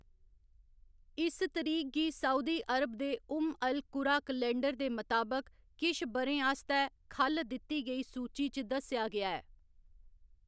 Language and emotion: Dogri, neutral